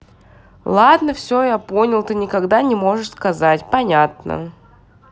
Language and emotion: Russian, neutral